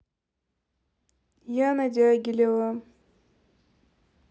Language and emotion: Russian, neutral